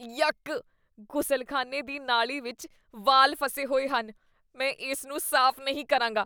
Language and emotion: Punjabi, disgusted